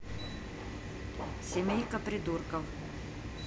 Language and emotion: Russian, neutral